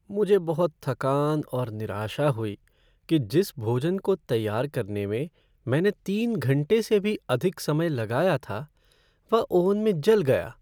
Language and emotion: Hindi, sad